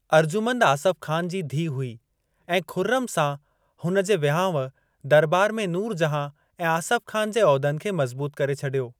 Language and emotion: Sindhi, neutral